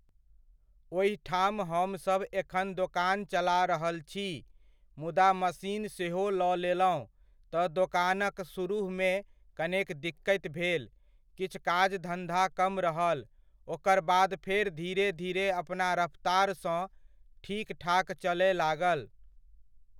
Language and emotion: Maithili, neutral